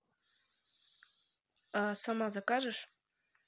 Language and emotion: Russian, neutral